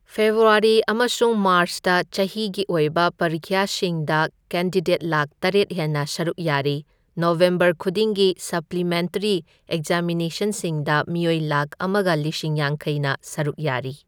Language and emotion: Manipuri, neutral